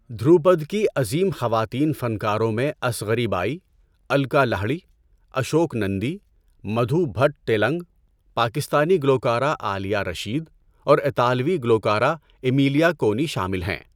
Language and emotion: Urdu, neutral